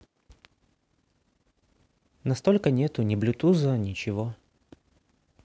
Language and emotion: Russian, sad